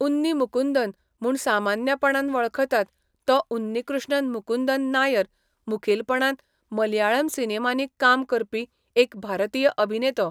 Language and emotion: Goan Konkani, neutral